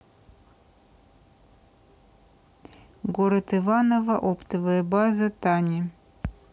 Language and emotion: Russian, neutral